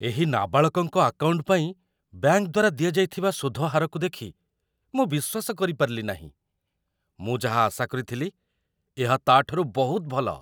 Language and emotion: Odia, surprised